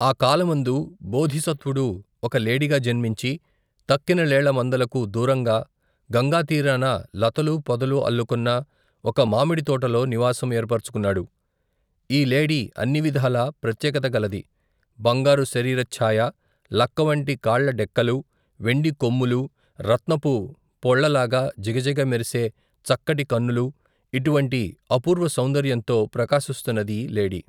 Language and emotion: Telugu, neutral